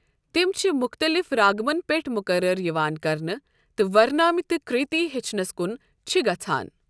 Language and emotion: Kashmiri, neutral